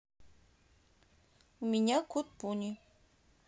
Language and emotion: Russian, neutral